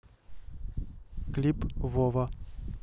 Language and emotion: Russian, neutral